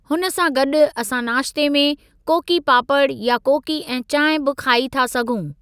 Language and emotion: Sindhi, neutral